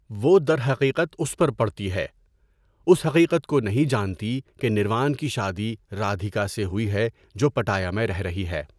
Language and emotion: Urdu, neutral